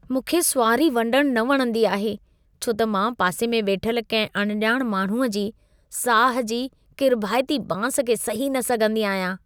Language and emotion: Sindhi, disgusted